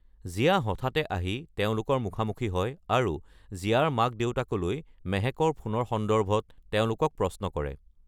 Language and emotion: Assamese, neutral